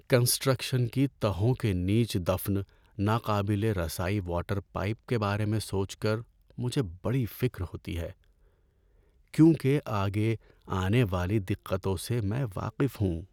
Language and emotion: Urdu, sad